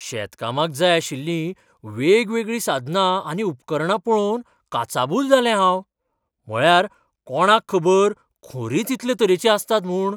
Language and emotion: Goan Konkani, surprised